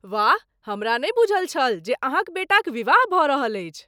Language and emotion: Maithili, surprised